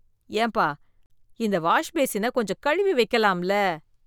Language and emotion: Tamil, disgusted